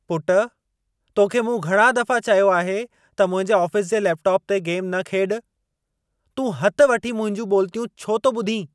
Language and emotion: Sindhi, angry